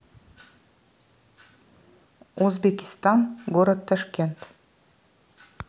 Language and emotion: Russian, neutral